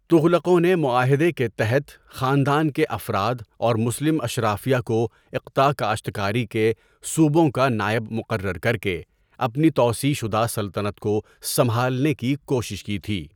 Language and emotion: Urdu, neutral